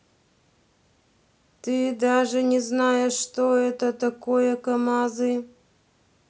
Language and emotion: Russian, neutral